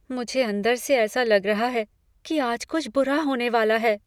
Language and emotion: Hindi, fearful